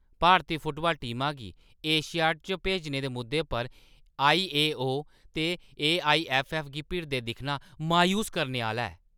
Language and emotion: Dogri, angry